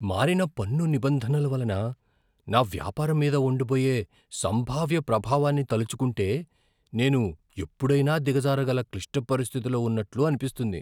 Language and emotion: Telugu, fearful